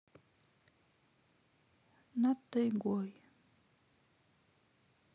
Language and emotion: Russian, sad